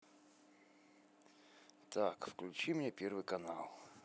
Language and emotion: Russian, neutral